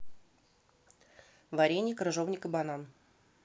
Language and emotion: Russian, neutral